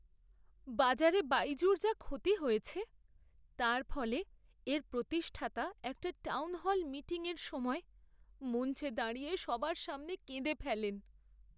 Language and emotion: Bengali, sad